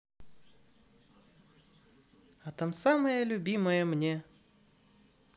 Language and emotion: Russian, positive